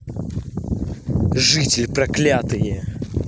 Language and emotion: Russian, angry